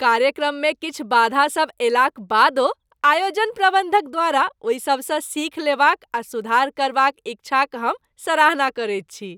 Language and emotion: Maithili, happy